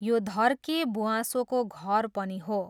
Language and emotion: Nepali, neutral